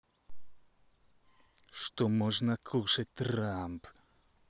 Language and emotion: Russian, angry